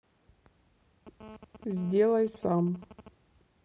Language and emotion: Russian, neutral